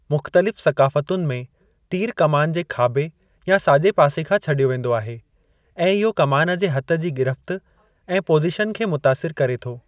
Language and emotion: Sindhi, neutral